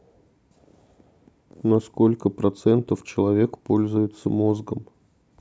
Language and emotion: Russian, neutral